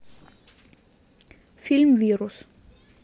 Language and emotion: Russian, neutral